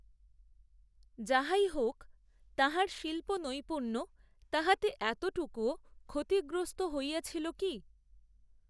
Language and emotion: Bengali, neutral